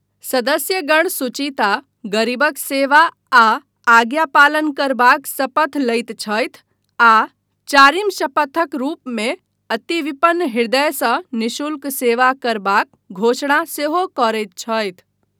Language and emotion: Maithili, neutral